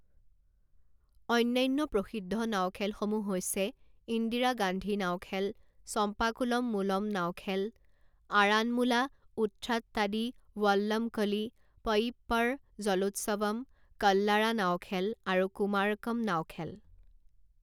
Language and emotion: Assamese, neutral